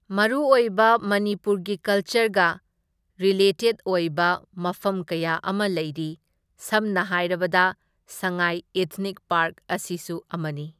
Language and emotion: Manipuri, neutral